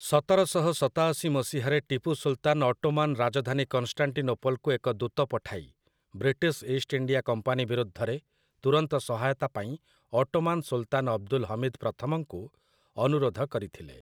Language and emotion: Odia, neutral